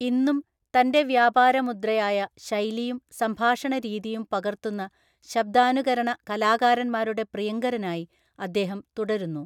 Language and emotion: Malayalam, neutral